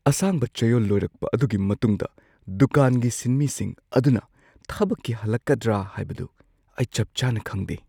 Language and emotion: Manipuri, fearful